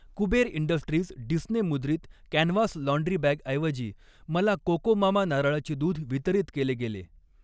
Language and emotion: Marathi, neutral